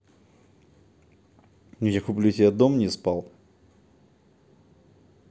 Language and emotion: Russian, neutral